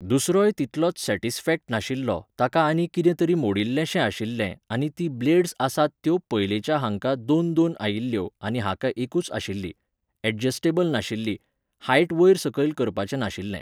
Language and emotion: Goan Konkani, neutral